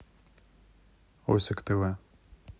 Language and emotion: Russian, neutral